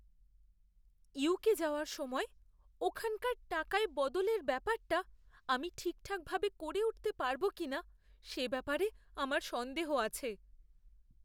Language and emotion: Bengali, fearful